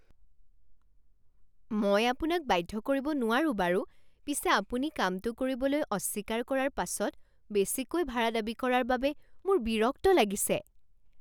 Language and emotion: Assamese, surprised